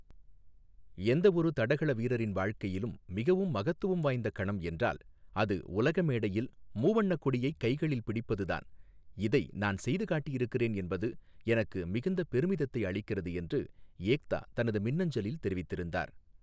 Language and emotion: Tamil, neutral